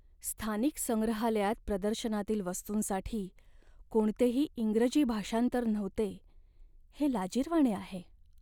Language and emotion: Marathi, sad